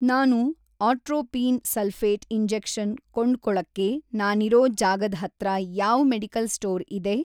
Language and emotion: Kannada, neutral